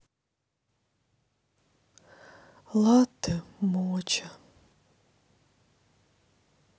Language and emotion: Russian, sad